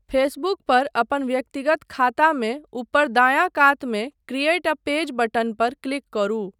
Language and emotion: Maithili, neutral